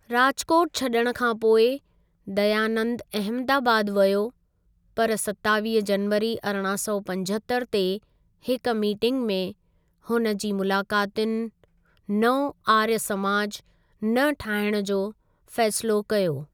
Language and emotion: Sindhi, neutral